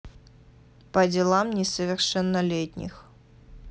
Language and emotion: Russian, neutral